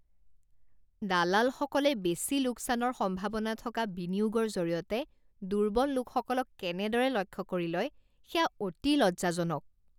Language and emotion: Assamese, disgusted